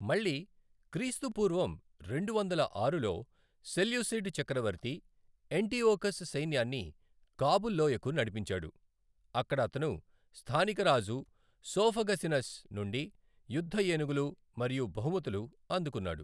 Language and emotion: Telugu, neutral